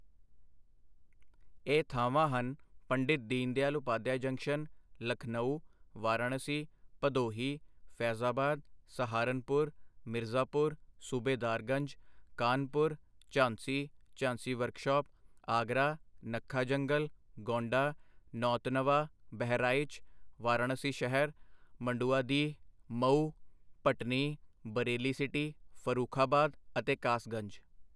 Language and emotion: Punjabi, neutral